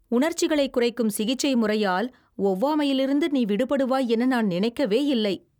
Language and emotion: Tamil, surprised